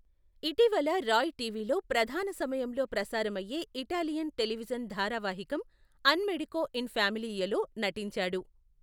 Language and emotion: Telugu, neutral